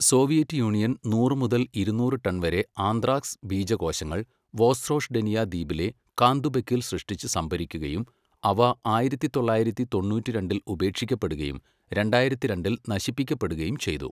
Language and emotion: Malayalam, neutral